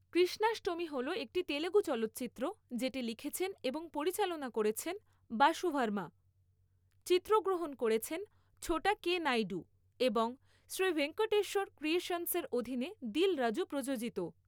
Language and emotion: Bengali, neutral